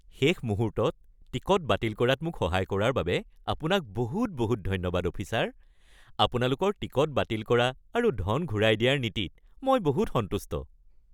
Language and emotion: Assamese, happy